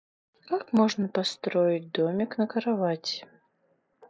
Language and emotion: Russian, sad